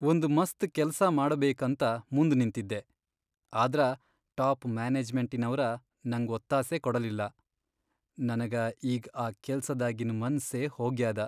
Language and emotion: Kannada, sad